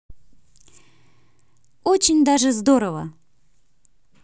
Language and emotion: Russian, positive